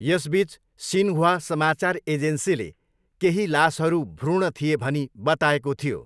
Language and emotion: Nepali, neutral